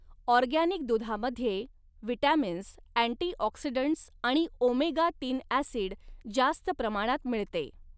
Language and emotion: Marathi, neutral